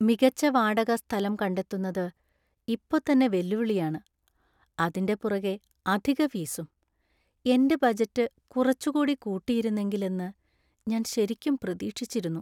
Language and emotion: Malayalam, sad